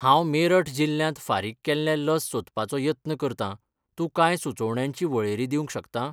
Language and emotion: Goan Konkani, neutral